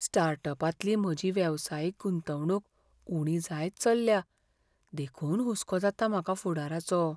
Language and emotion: Goan Konkani, fearful